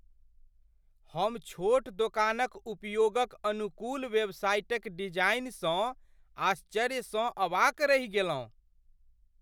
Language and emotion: Maithili, surprised